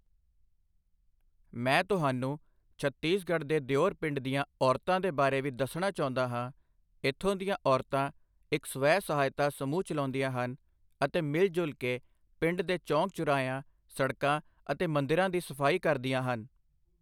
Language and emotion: Punjabi, neutral